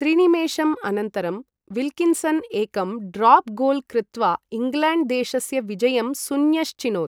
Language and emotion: Sanskrit, neutral